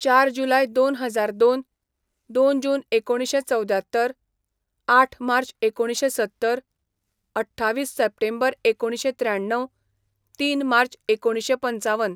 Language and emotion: Goan Konkani, neutral